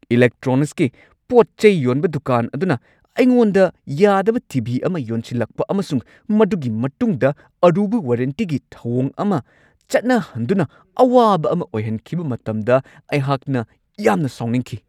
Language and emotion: Manipuri, angry